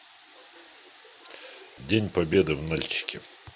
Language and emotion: Russian, neutral